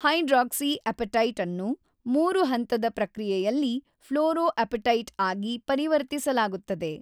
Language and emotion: Kannada, neutral